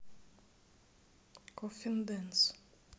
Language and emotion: Russian, neutral